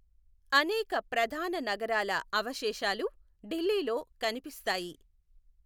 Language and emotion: Telugu, neutral